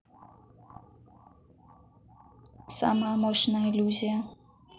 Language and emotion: Russian, neutral